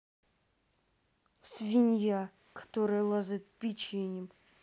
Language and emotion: Russian, angry